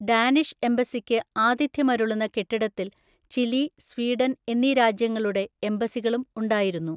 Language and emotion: Malayalam, neutral